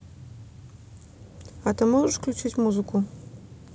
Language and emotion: Russian, neutral